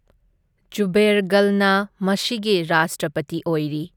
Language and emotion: Manipuri, neutral